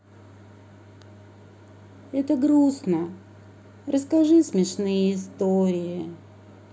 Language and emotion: Russian, sad